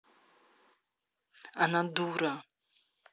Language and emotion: Russian, angry